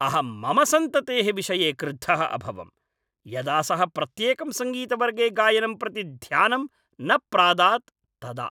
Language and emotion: Sanskrit, angry